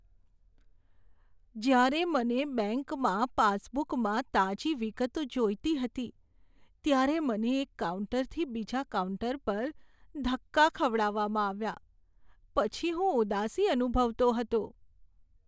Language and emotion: Gujarati, sad